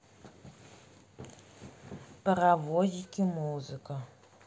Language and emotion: Russian, neutral